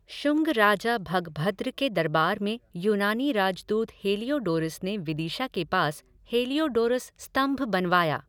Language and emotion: Hindi, neutral